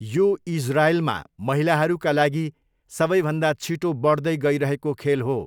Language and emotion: Nepali, neutral